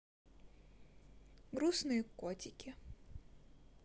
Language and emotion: Russian, sad